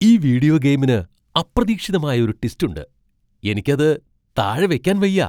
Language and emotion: Malayalam, surprised